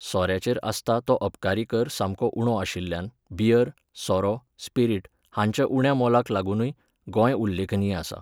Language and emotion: Goan Konkani, neutral